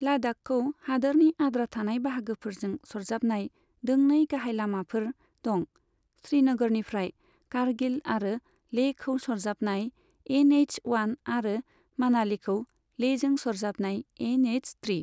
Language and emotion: Bodo, neutral